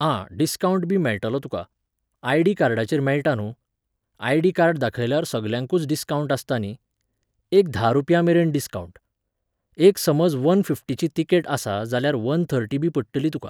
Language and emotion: Goan Konkani, neutral